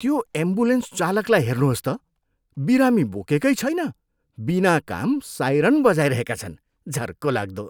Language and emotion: Nepali, disgusted